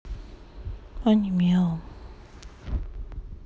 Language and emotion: Russian, sad